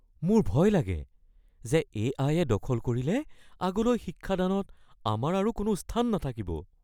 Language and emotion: Assamese, fearful